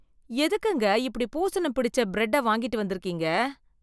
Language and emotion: Tamil, disgusted